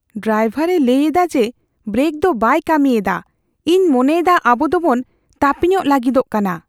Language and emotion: Santali, fearful